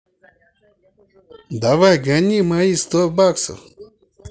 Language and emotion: Russian, angry